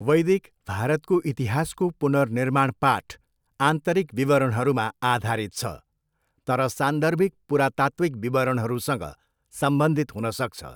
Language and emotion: Nepali, neutral